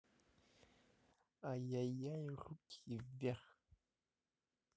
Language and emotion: Russian, neutral